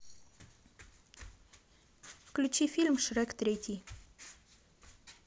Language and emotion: Russian, neutral